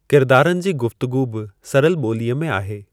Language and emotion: Sindhi, neutral